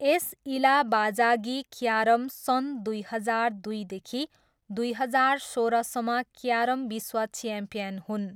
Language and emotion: Nepali, neutral